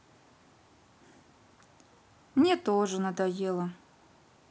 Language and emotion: Russian, sad